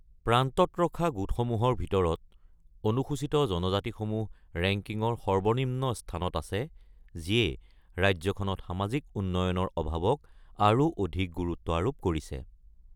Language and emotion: Assamese, neutral